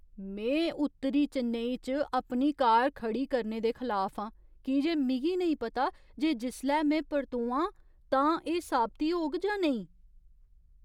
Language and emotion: Dogri, fearful